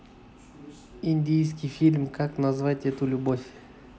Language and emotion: Russian, neutral